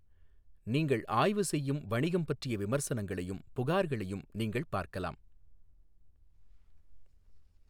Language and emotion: Tamil, neutral